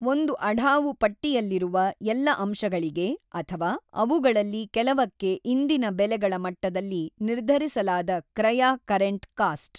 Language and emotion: Kannada, neutral